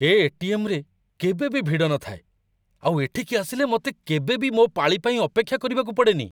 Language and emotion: Odia, surprised